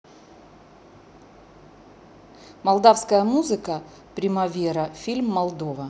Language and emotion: Russian, neutral